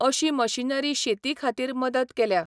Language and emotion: Goan Konkani, neutral